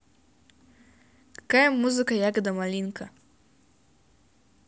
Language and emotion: Russian, positive